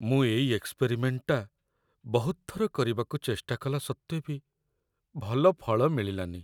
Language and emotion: Odia, sad